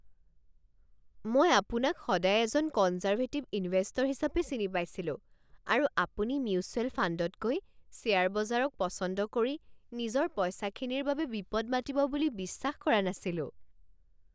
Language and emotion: Assamese, surprised